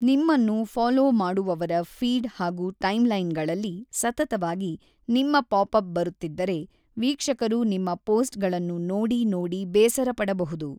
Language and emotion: Kannada, neutral